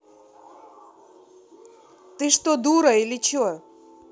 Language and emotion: Russian, angry